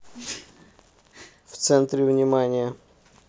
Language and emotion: Russian, neutral